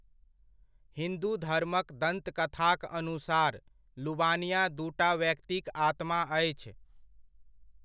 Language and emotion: Maithili, neutral